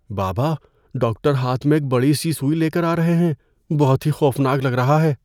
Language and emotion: Urdu, fearful